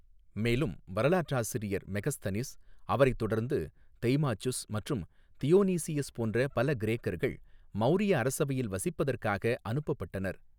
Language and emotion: Tamil, neutral